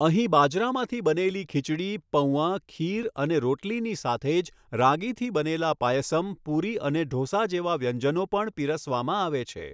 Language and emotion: Gujarati, neutral